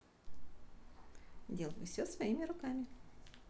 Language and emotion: Russian, positive